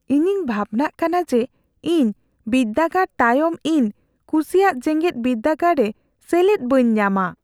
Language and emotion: Santali, fearful